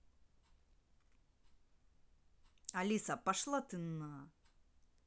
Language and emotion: Russian, angry